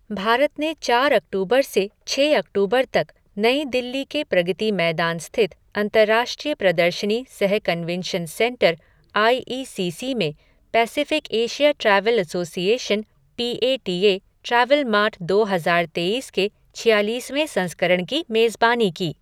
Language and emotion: Hindi, neutral